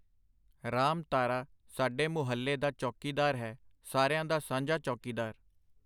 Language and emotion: Punjabi, neutral